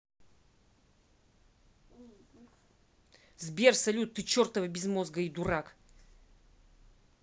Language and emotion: Russian, angry